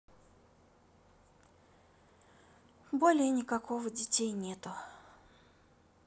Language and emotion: Russian, sad